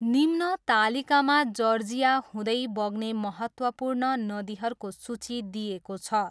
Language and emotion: Nepali, neutral